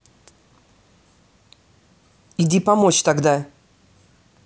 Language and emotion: Russian, angry